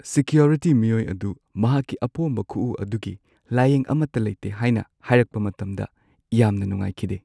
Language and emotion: Manipuri, sad